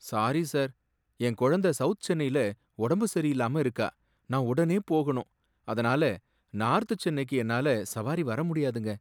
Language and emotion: Tamil, sad